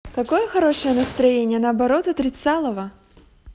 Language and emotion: Russian, positive